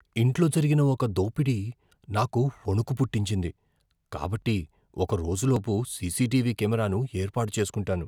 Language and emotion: Telugu, fearful